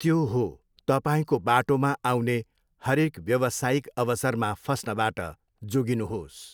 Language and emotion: Nepali, neutral